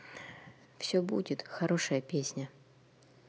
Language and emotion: Russian, neutral